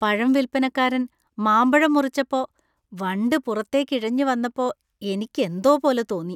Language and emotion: Malayalam, disgusted